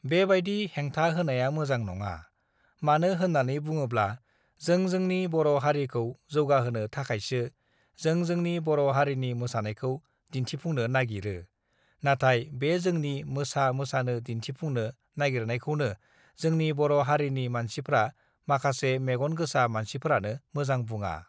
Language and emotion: Bodo, neutral